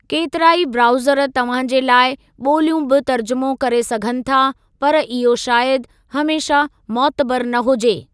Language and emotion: Sindhi, neutral